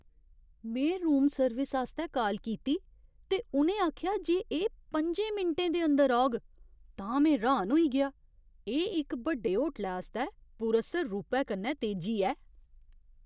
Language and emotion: Dogri, surprised